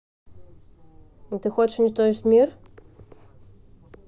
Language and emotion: Russian, neutral